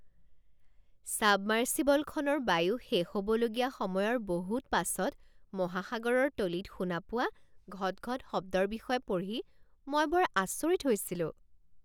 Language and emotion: Assamese, surprised